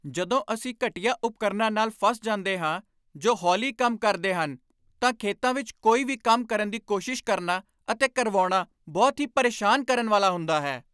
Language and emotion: Punjabi, angry